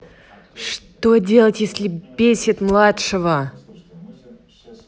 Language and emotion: Russian, angry